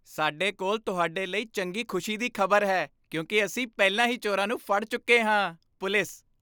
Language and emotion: Punjabi, happy